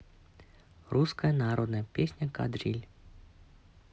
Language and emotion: Russian, neutral